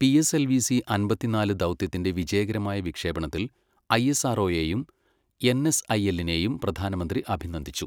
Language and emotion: Malayalam, neutral